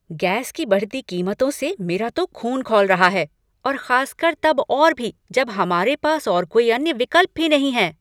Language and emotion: Hindi, angry